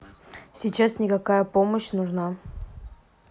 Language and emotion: Russian, neutral